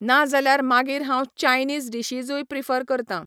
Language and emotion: Goan Konkani, neutral